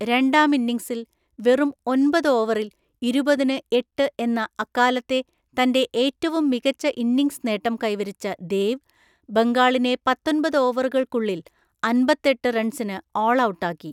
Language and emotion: Malayalam, neutral